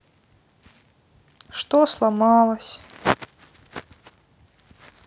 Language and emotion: Russian, sad